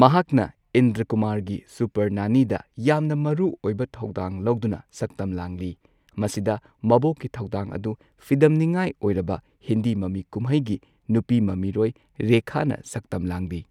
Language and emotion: Manipuri, neutral